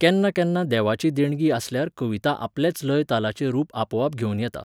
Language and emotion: Goan Konkani, neutral